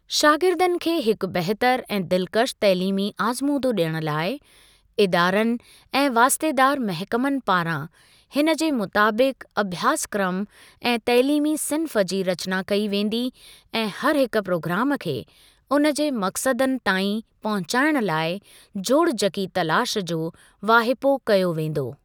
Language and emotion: Sindhi, neutral